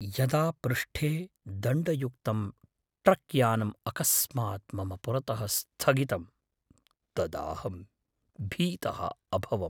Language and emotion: Sanskrit, fearful